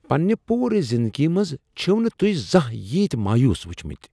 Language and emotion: Kashmiri, surprised